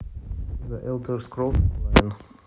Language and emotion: Russian, neutral